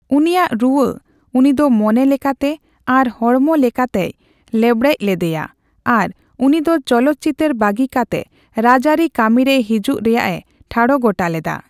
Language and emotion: Santali, neutral